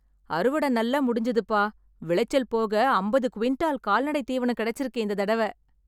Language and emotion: Tamil, happy